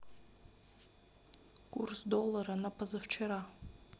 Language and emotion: Russian, neutral